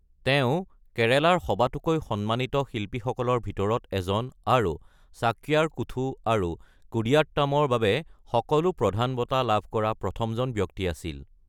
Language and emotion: Assamese, neutral